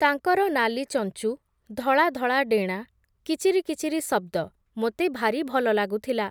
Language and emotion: Odia, neutral